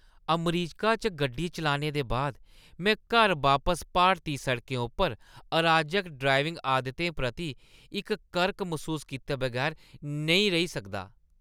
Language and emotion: Dogri, disgusted